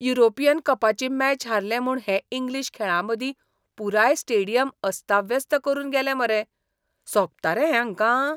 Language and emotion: Goan Konkani, disgusted